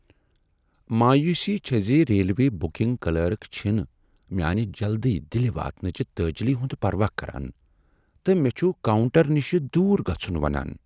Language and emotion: Kashmiri, sad